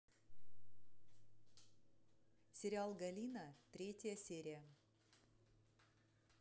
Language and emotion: Russian, neutral